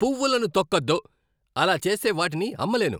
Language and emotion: Telugu, angry